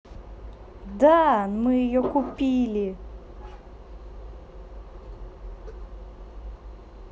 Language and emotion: Russian, positive